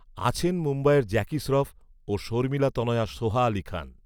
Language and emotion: Bengali, neutral